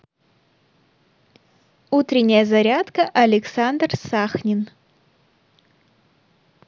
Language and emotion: Russian, neutral